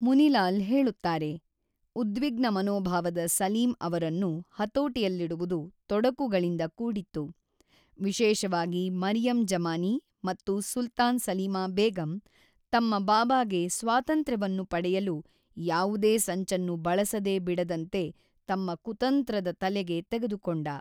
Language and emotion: Kannada, neutral